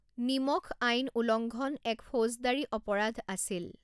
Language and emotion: Assamese, neutral